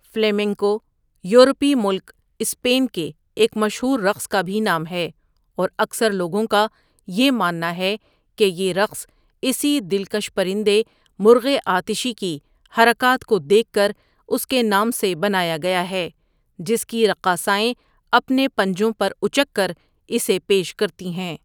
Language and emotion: Urdu, neutral